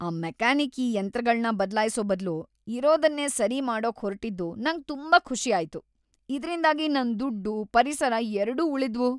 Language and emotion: Kannada, happy